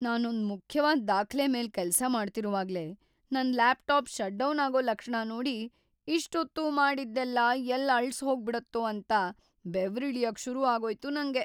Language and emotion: Kannada, fearful